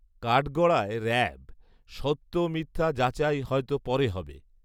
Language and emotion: Bengali, neutral